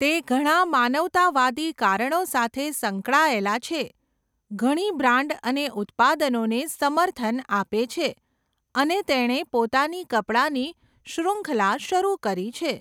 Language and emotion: Gujarati, neutral